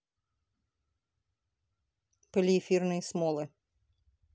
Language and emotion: Russian, neutral